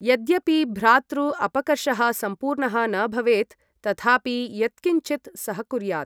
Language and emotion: Sanskrit, neutral